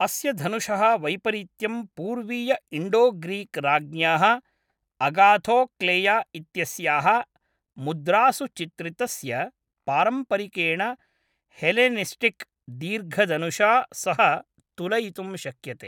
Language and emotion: Sanskrit, neutral